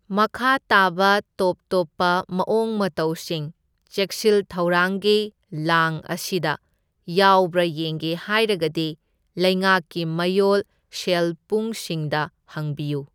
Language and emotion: Manipuri, neutral